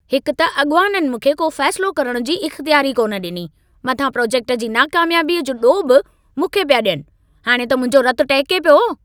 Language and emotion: Sindhi, angry